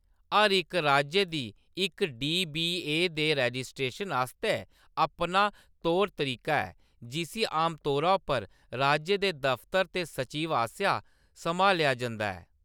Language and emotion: Dogri, neutral